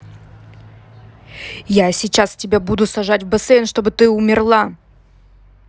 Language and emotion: Russian, angry